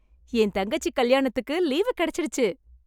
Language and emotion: Tamil, happy